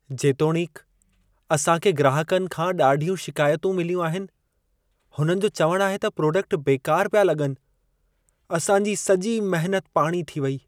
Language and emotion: Sindhi, sad